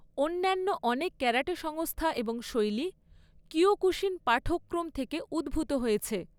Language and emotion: Bengali, neutral